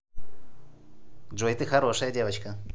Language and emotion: Russian, positive